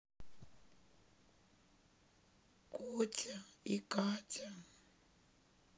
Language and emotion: Russian, sad